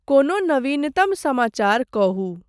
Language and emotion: Maithili, neutral